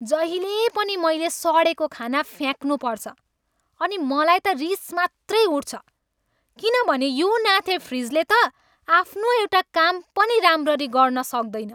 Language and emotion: Nepali, angry